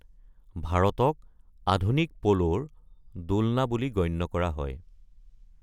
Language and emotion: Assamese, neutral